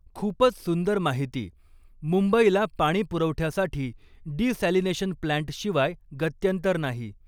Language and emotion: Marathi, neutral